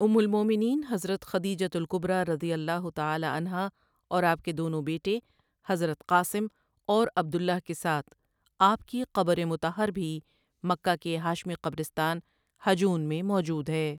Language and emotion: Urdu, neutral